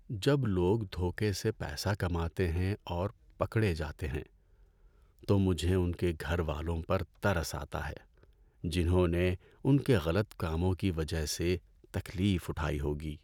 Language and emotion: Urdu, sad